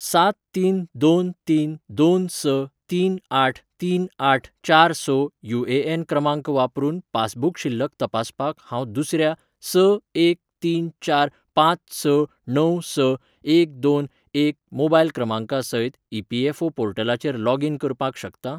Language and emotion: Goan Konkani, neutral